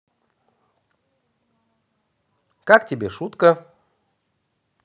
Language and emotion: Russian, positive